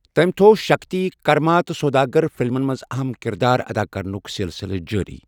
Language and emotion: Kashmiri, neutral